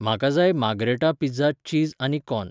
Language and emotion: Goan Konkani, neutral